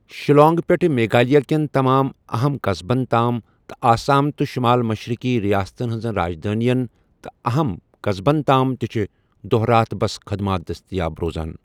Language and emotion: Kashmiri, neutral